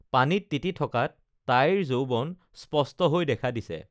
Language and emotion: Assamese, neutral